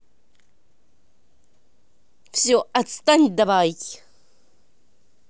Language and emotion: Russian, angry